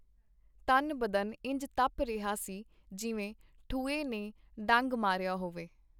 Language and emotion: Punjabi, neutral